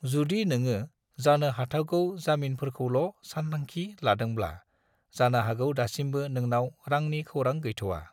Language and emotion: Bodo, neutral